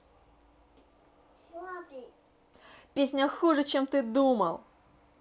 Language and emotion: Russian, angry